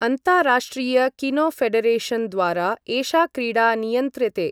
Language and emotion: Sanskrit, neutral